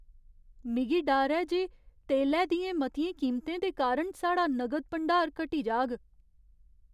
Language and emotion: Dogri, fearful